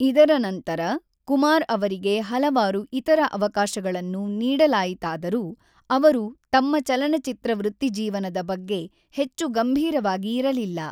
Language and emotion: Kannada, neutral